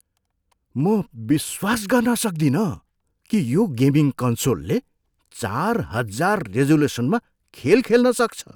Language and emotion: Nepali, surprised